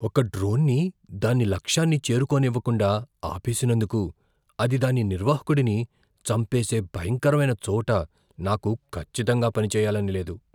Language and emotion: Telugu, fearful